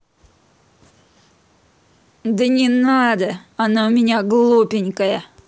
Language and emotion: Russian, neutral